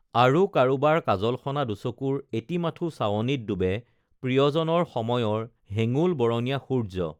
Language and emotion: Assamese, neutral